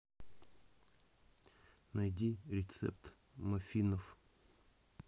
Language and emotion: Russian, neutral